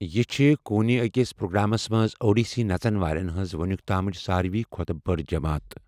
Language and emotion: Kashmiri, neutral